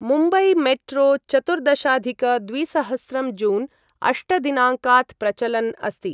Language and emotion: Sanskrit, neutral